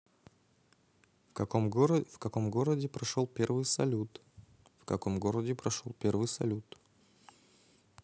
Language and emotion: Russian, neutral